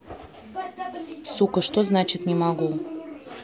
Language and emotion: Russian, angry